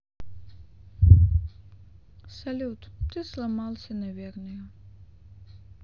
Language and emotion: Russian, sad